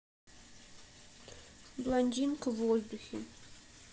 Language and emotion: Russian, sad